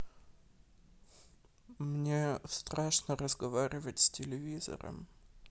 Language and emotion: Russian, sad